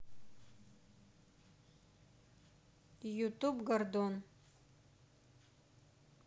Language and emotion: Russian, neutral